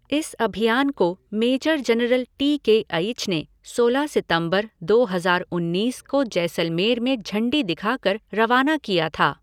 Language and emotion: Hindi, neutral